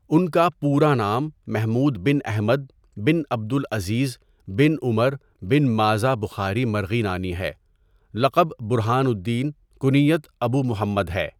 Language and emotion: Urdu, neutral